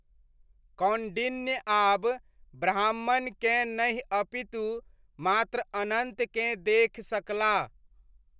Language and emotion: Maithili, neutral